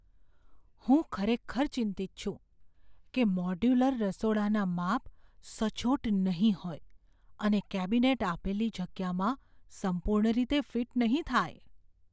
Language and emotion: Gujarati, fearful